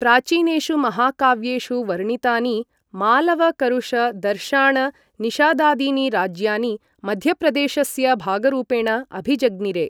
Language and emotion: Sanskrit, neutral